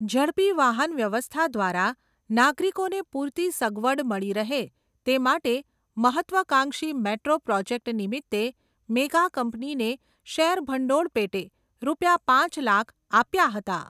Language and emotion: Gujarati, neutral